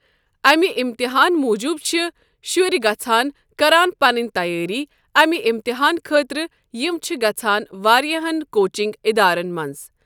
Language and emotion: Kashmiri, neutral